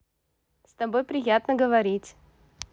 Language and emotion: Russian, positive